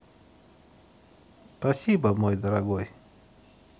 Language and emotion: Russian, neutral